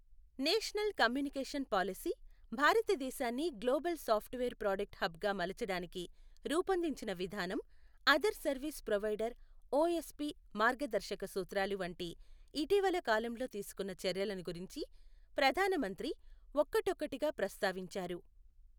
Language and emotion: Telugu, neutral